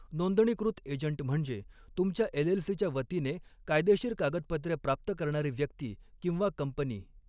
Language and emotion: Marathi, neutral